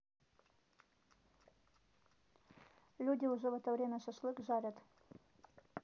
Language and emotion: Russian, neutral